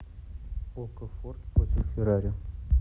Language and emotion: Russian, neutral